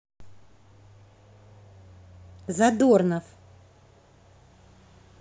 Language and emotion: Russian, positive